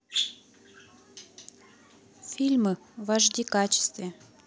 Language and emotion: Russian, neutral